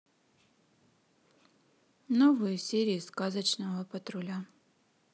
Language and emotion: Russian, neutral